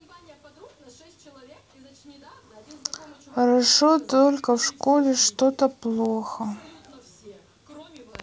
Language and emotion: Russian, sad